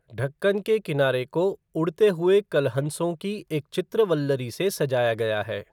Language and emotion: Hindi, neutral